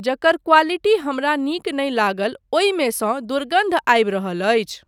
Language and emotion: Maithili, neutral